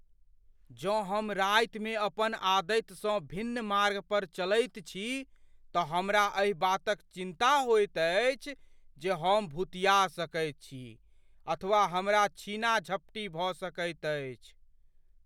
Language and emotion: Maithili, fearful